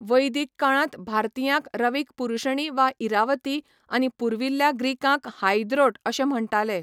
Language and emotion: Goan Konkani, neutral